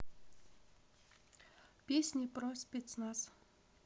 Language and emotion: Russian, neutral